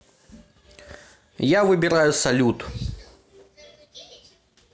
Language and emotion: Russian, neutral